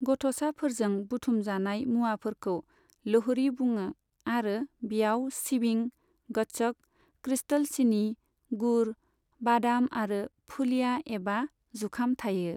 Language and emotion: Bodo, neutral